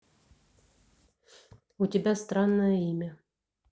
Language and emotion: Russian, neutral